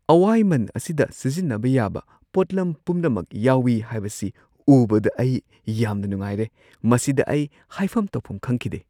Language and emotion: Manipuri, surprised